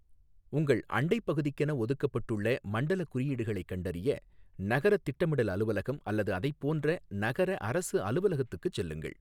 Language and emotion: Tamil, neutral